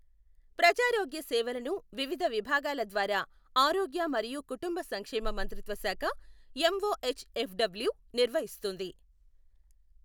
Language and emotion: Telugu, neutral